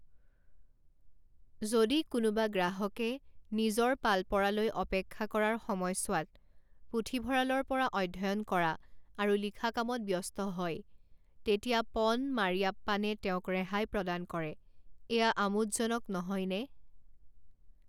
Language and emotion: Assamese, neutral